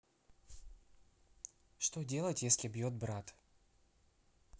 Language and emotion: Russian, neutral